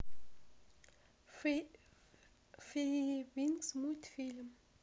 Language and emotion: Russian, neutral